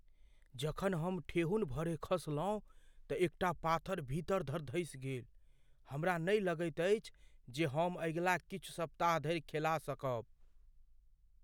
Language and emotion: Maithili, fearful